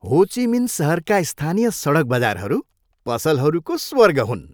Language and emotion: Nepali, happy